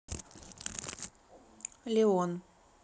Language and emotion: Russian, neutral